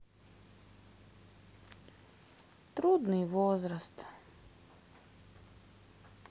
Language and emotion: Russian, sad